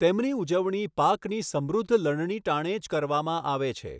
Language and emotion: Gujarati, neutral